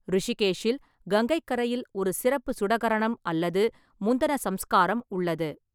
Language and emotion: Tamil, neutral